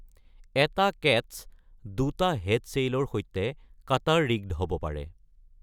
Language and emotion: Assamese, neutral